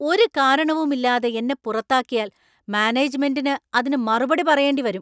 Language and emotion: Malayalam, angry